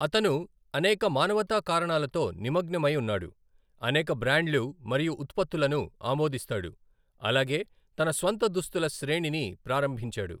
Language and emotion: Telugu, neutral